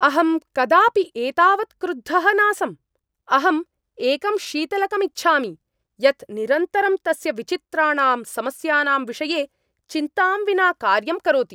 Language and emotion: Sanskrit, angry